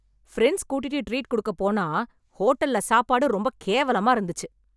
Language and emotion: Tamil, angry